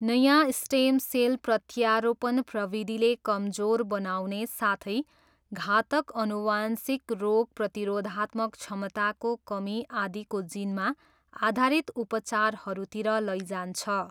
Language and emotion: Nepali, neutral